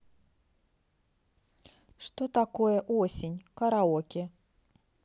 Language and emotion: Russian, neutral